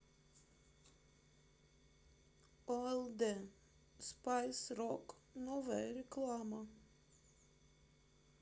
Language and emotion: Russian, sad